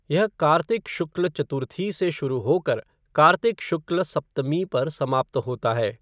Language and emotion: Hindi, neutral